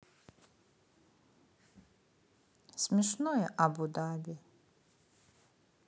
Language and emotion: Russian, sad